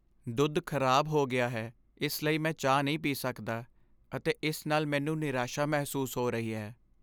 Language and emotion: Punjabi, sad